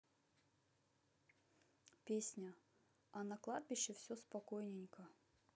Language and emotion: Russian, neutral